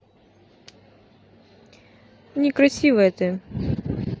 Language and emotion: Russian, neutral